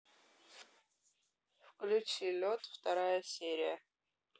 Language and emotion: Russian, neutral